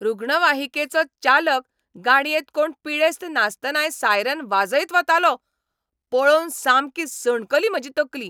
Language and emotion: Goan Konkani, angry